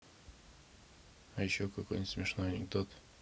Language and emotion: Russian, neutral